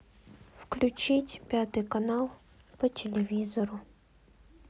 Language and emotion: Russian, sad